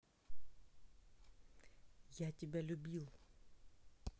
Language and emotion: Russian, sad